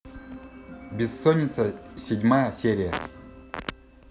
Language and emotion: Russian, neutral